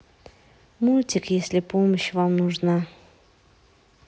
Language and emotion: Russian, sad